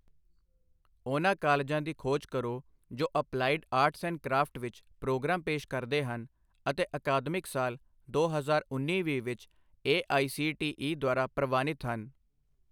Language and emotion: Punjabi, neutral